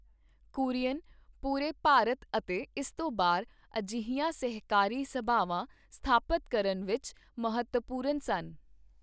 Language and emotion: Punjabi, neutral